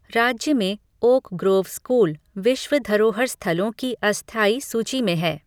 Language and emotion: Hindi, neutral